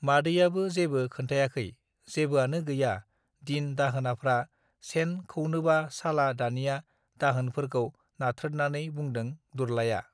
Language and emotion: Bodo, neutral